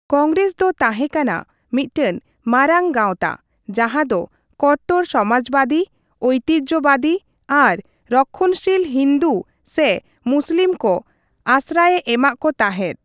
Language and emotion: Santali, neutral